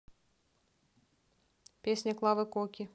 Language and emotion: Russian, neutral